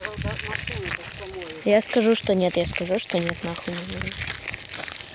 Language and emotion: Russian, neutral